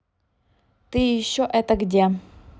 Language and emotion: Russian, neutral